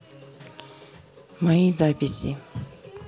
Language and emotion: Russian, neutral